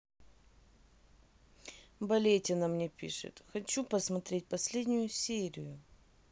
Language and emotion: Russian, neutral